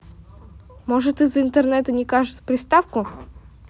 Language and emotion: Russian, neutral